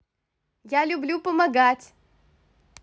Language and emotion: Russian, positive